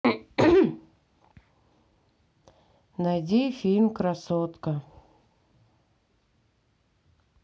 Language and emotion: Russian, neutral